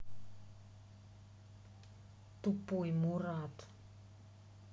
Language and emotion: Russian, angry